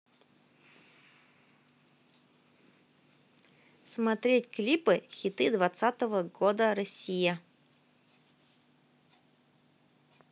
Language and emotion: Russian, neutral